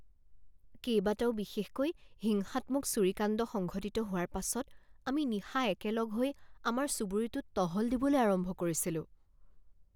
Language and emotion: Assamese, fearful